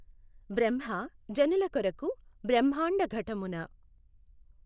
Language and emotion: Telugu, neutral